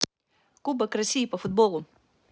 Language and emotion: Russian, neutral